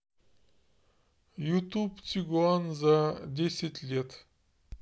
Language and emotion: Russian, neutral